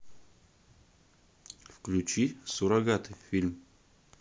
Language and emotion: Russian, neutral